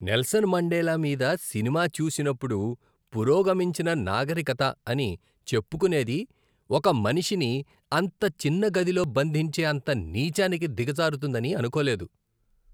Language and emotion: Telugu, disgusted